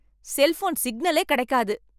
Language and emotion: Tamil, angry